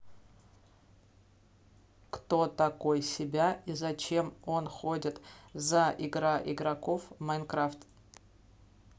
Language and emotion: Russian, neutral